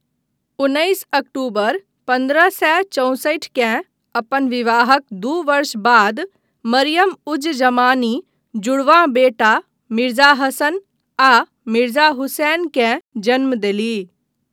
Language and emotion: Maithili, neutral